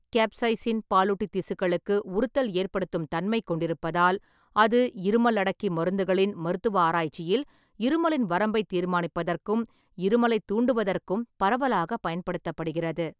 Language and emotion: Tamil, neutral